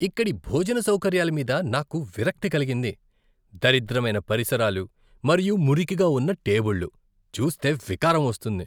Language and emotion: Telugu, disgusted